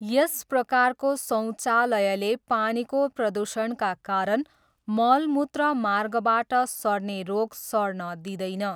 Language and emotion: Nepali, neutral